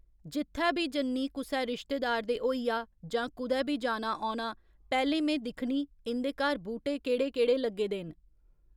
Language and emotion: Dogri, neutral